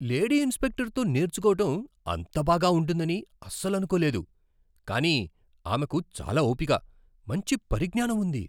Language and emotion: Telugu, surprised